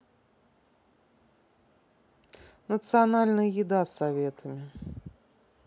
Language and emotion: Russian, neutral